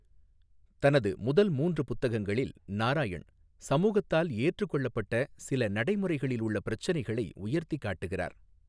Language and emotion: Tamil, neutral